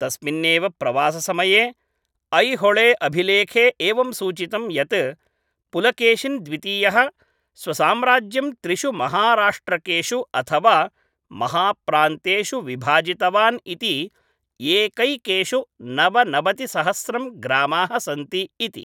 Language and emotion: Sanskrit, neutral